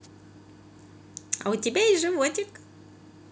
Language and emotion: Russian, positive